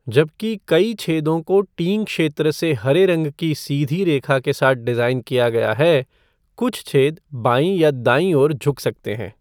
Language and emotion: Hindi, neutral